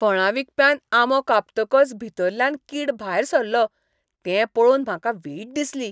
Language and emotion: Goan Konkani, disgusted